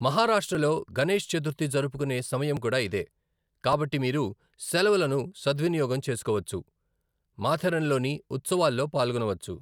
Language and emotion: Telugu, neutral